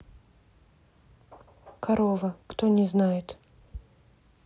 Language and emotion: Russian, neutral